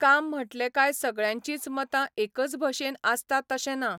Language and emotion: Goan Konkani, neutral